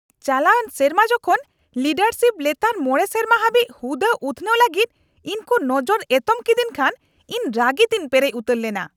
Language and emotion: Santali, angry